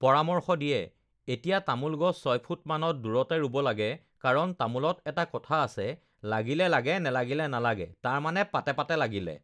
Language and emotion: Assamese, neutral